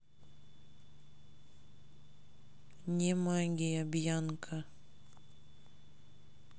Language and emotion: Russian, neutral